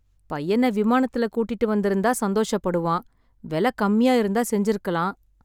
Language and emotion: Tamil, sad